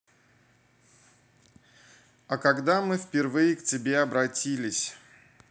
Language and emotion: Russian, neutral